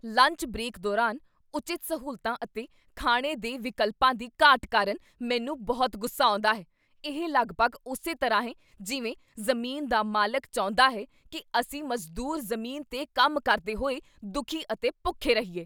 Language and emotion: Punjabi, angry